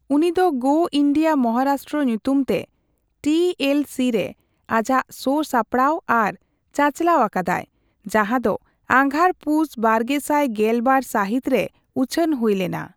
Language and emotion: Santali, neutral